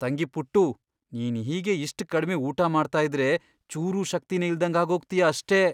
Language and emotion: Kannada, fearful